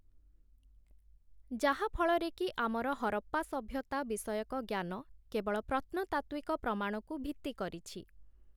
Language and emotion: Odia, neutral